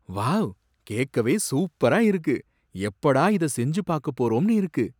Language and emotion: Tamil, surprised